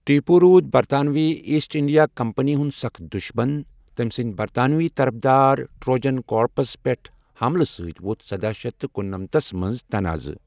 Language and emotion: Kashmiri, neutral